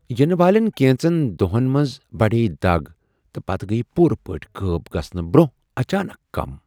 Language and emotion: Kashmiri, surprised